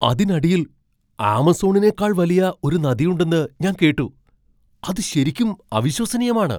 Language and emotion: Malayalam, surprised